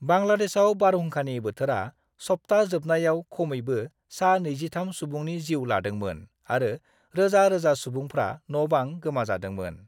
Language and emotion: Bodo, neutral